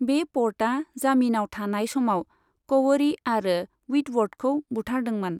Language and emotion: Bodo, neutral